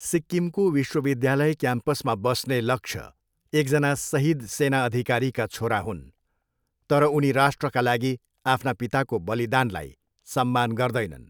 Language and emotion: Nepali, neutral